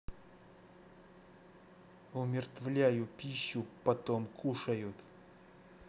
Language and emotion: Russian, angry